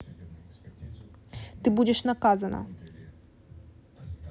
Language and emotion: Russian, angry